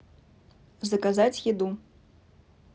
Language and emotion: Russian, neutral